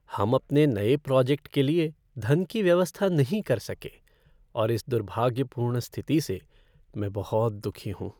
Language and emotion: Hindi, sad